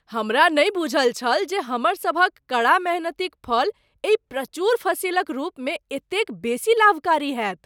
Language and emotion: Maithili, surprised